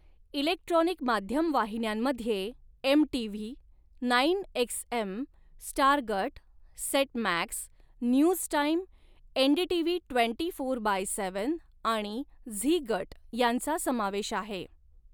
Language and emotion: Marathi, neutral